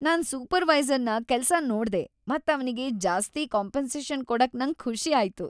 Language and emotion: Kannada, happy